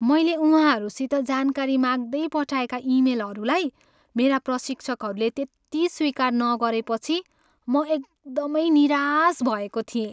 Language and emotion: Nepali, sad